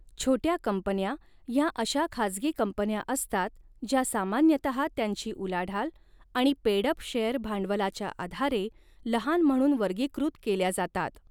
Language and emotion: Marathi, neutral